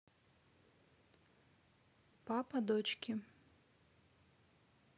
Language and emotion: Russian, neutral